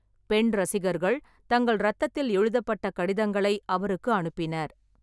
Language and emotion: Tamil, neutral